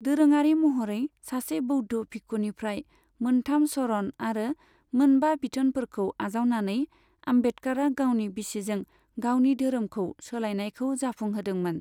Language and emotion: Bodo, neutral